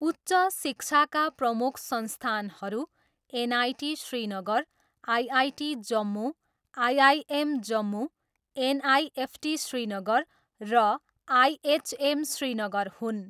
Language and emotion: Nepali, neutral